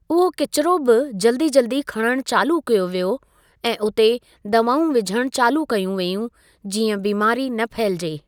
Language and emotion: Sindhi, neutral